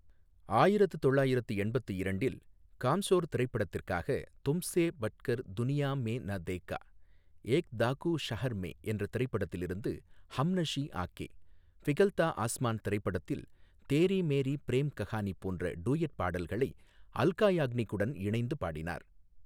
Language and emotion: Tamil, neutral